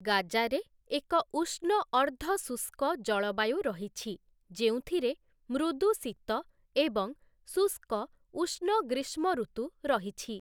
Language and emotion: Odia, neutral